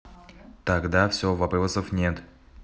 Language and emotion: Russian, neutral